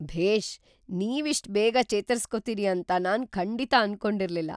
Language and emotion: Kannada, surprised